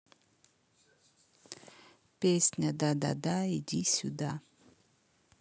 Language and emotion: Russian, neutral